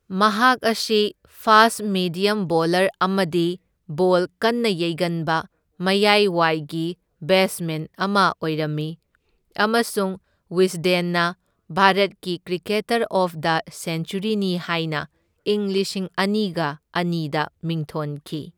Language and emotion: Manipuri, neutral